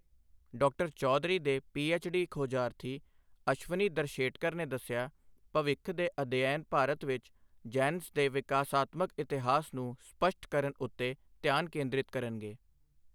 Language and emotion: Punjabi, neutral